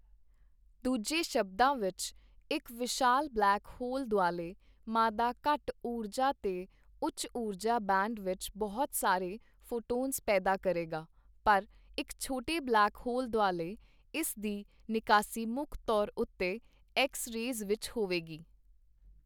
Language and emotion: Punjabi, neutral